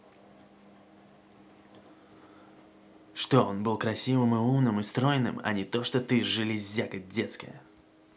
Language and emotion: Russian, angry